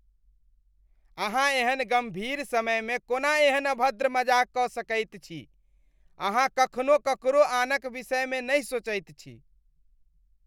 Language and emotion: Maithili, disgusted